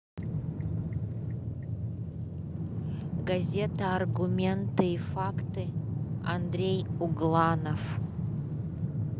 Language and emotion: Russian, neutral